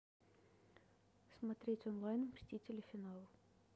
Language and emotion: Russian, neutral